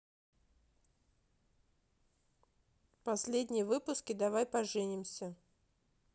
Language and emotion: Russian, neutral